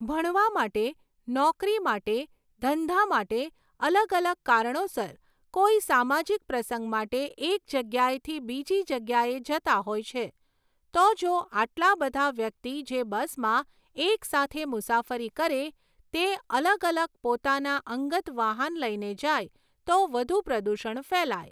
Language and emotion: Gujarati, neutral